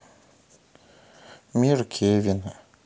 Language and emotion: Russian, sad